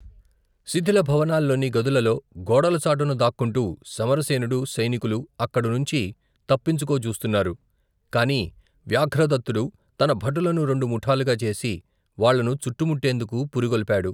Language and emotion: Telugu, neutral